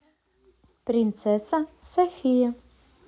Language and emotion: Russian, positive